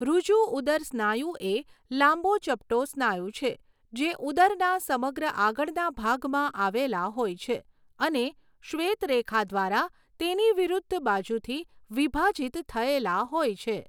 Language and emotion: Gujarati, neutral